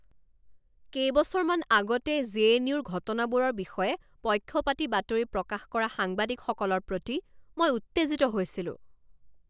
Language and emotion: Assamese, angry